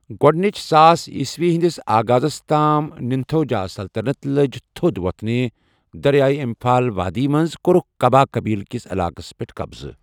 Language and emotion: Kashmiri, neutral